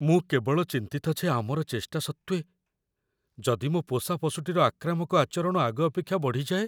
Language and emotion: Odia, fearful